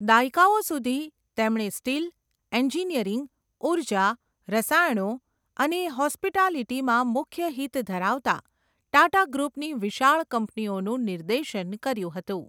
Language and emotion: Gujarati, neutral